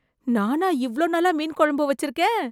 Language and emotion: Tamil, surprised